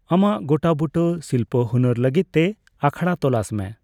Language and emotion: Santali, neutral